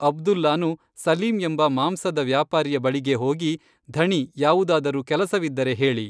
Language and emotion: Kannada, neutral